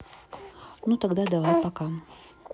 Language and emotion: Russian, neutral